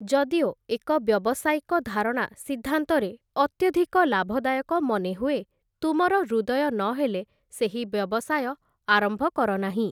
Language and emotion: Odia, neutral